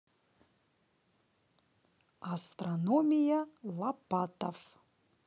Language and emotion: Russian, positive